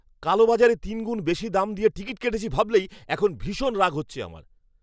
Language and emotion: Bengali, angry